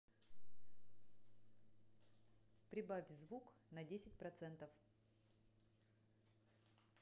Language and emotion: Russian, neutral